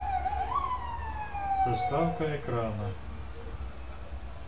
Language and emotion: Russian, neutral